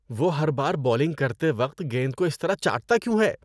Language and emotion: Urdu, disgusted